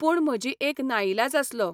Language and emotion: Goan Konkani, neutral